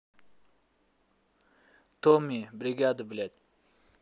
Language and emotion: Russian, angry